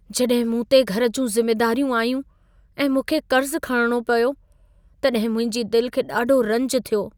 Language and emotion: Sindhi, sad